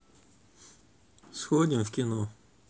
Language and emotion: Russian, neutral